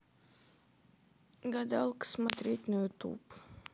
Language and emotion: Russian, sad